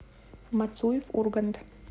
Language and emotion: Russian, neutral